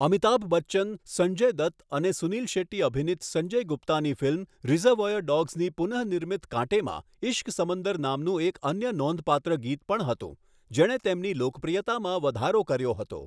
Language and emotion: Gujarati, neutral